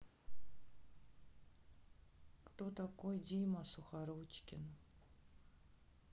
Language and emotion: Russian, sad